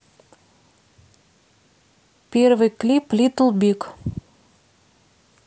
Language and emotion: Russian, neutral